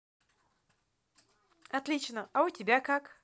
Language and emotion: Russian, positive